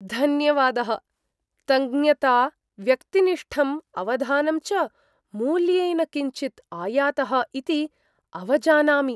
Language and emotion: Sanskrit, surprised